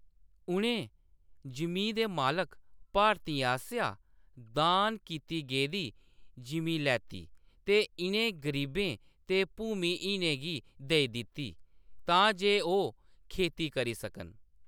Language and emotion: Dogri, neutral